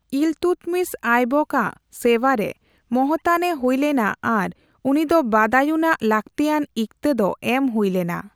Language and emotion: Santali, neutral